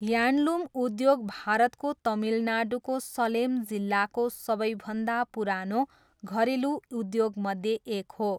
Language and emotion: Nepali, neutral